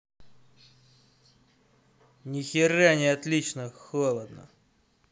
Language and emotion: Russian, angry